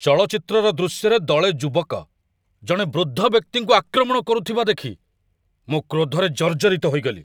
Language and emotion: Odia, angry